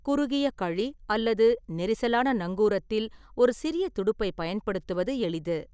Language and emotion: Tamil, neutral